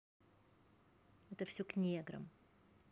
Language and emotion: Russian, neutral